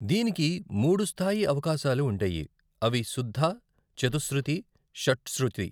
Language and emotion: Telugu, neutral